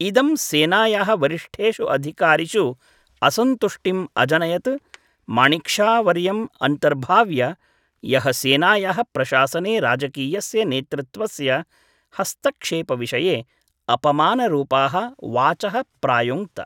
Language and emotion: Sanskrit, neutral